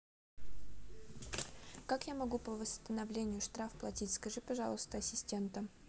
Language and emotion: Russian, neutral